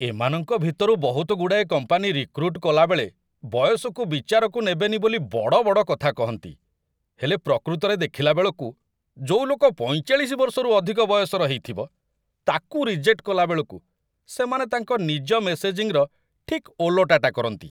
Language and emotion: Odia, disgusted